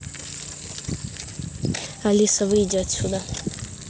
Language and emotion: Russian, neutral